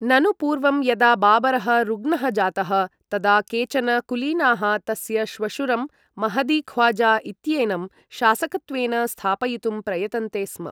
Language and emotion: Sanskrit, neutral